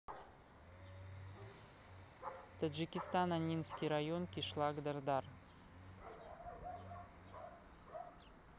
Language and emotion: Russian, neutral